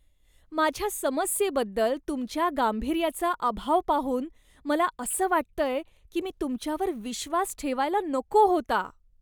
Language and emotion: Marathi, disgusted